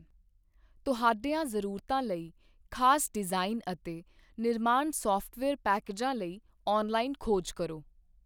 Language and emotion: Punjabi, neutral